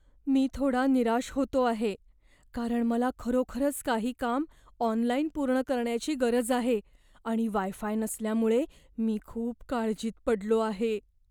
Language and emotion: Marathi, fearful